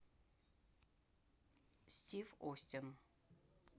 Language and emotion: Russian, neutral